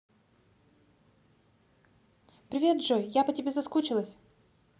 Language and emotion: Russian, positive